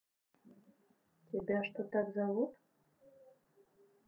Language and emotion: Russian, neutral